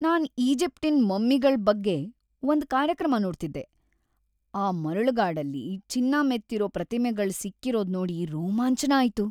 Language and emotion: Kannada, happy